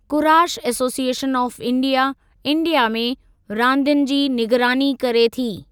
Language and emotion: Sindhi, neutral